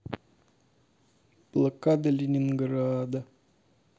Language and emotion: Russian, sad